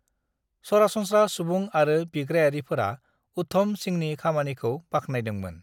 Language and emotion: Bodo, neutral